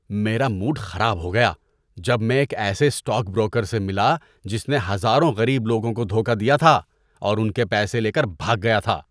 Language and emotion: Urdu, disgusted